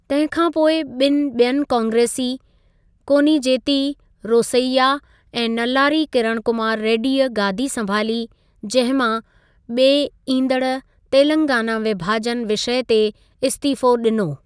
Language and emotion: Sindhi, neutral